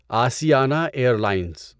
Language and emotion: Urdu, neutral